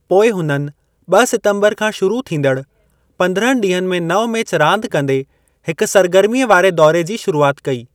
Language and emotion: Sindhi, neutral